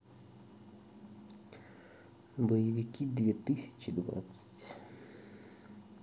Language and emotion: Russian, neutral